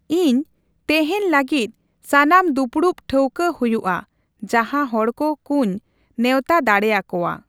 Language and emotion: Santali, neutral